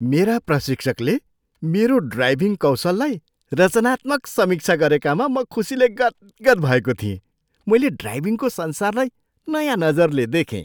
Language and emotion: Nepali, surprised